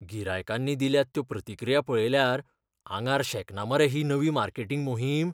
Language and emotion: Goan Konkani, fearful